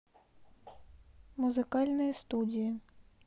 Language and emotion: Russian, neutral